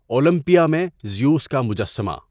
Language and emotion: Urdu, neutral